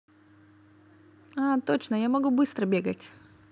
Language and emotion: Russian, positive